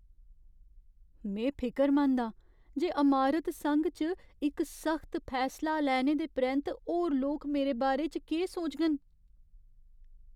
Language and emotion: Dogri, fearful